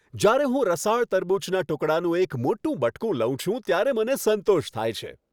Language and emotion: Gujarati, happy